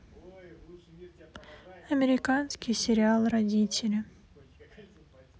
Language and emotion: Russian, sad